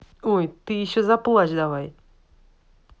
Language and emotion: Russian, angry